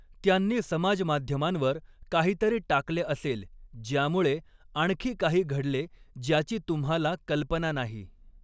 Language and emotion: Marathi, neutral